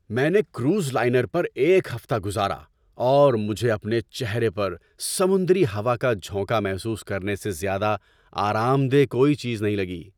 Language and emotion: Urdu, happy